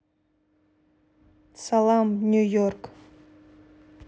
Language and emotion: Russian, neutral